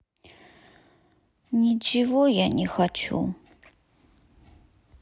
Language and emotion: Russian, sad